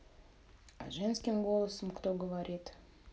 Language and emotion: Russian, neutral